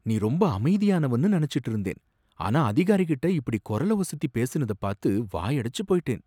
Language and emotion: Tamil, surprised